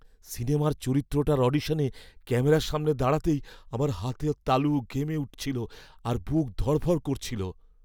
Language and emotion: Bengali, fearful